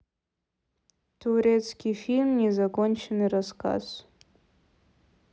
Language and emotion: Russian, neutral